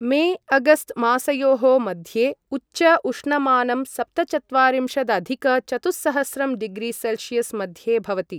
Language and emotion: Sanskrit, neutral